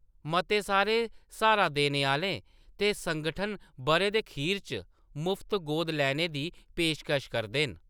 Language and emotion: Dogri, neutral